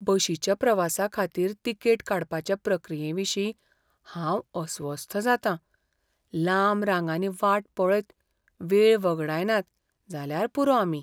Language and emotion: Goan Konkani, fearful